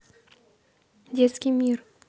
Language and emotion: Russian, neutral